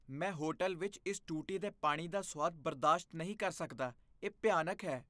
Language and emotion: Punjabi, disgusted